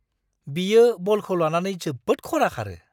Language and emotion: Bodo, surprised